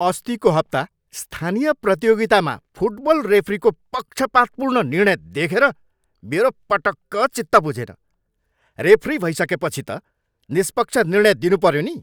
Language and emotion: Nepali, angry